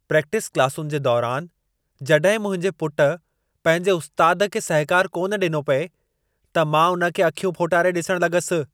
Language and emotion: Sindhi, angry